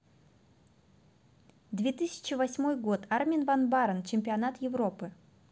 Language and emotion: Russian, neutral